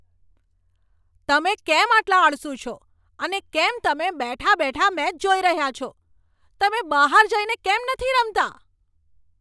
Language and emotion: Gujarati, angry